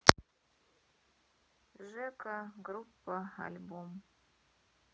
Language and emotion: Russian, sad